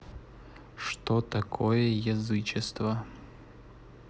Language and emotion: Russian, neutral